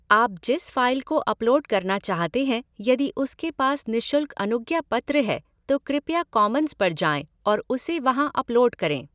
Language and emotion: Hindi, neutral